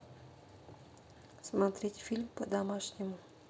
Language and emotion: Russian, neutral